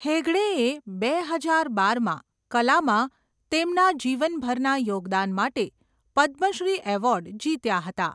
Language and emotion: Gujarati, neutral